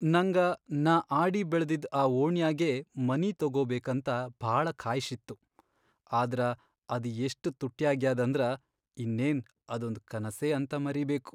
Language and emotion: Kannada, sad